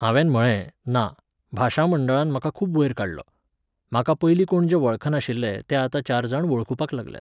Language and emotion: Goan Konkani, neutral